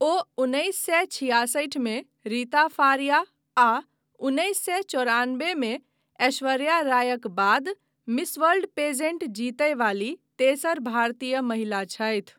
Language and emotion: Maithili, neutral